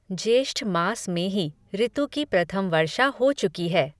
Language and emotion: Hindi, neutral